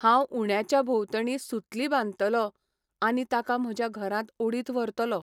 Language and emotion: Goan Konkani, neutral